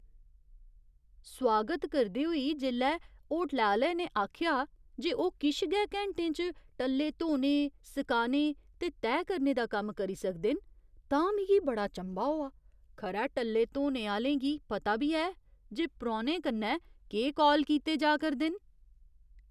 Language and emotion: Dogri, surprised